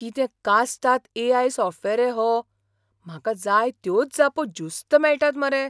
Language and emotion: Goan Konkani, surprised